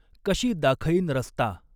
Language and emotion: Marathi, neutral